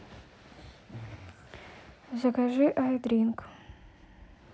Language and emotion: Russian, neutral